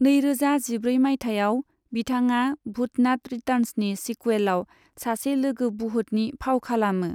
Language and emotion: Bodo, neutral